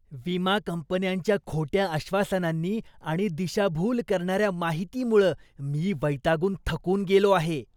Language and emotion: Marathi, disgusted